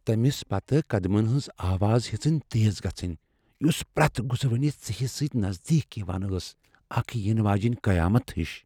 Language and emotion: Kashmiri, fearful